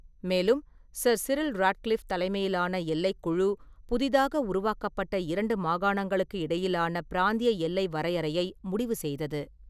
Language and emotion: Tamil, neutral